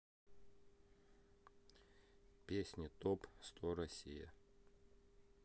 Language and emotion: Russian, neutral